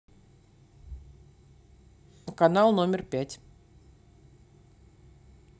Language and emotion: Russian, neutral